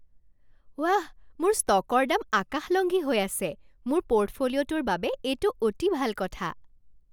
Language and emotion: Assamese, happy